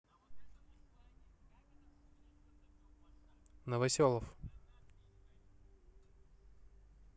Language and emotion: Russian, neutral